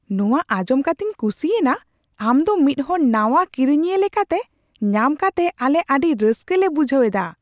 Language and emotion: Santali, surprised